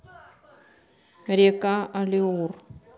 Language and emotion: Russian, neutral